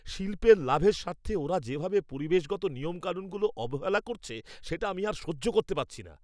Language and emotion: Bengali, angry